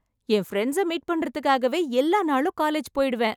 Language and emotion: Tamil, happy